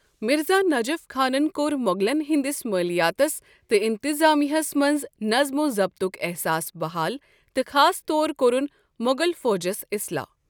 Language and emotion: Kashmiri, neutral